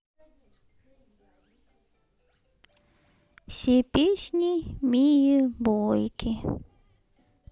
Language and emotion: Russian, sad